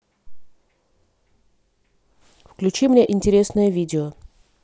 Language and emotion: Russian, neutral